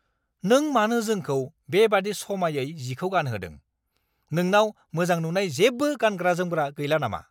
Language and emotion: Bodo, angry